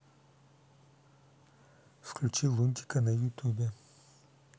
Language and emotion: Russian, neutral